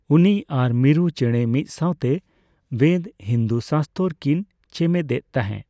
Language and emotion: Santali, neutral